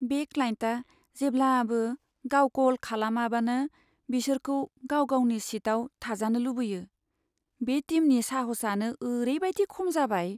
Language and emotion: Bodo, sad